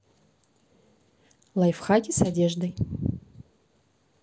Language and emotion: Russian, neutral